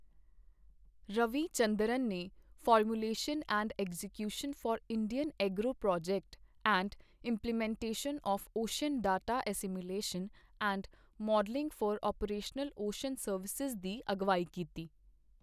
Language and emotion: Punjabi, neutral